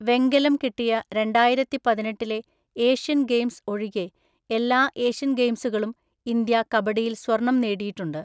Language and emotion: Malayalam, neutral